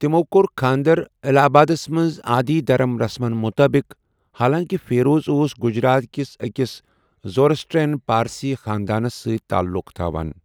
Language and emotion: Kashmiri, neutral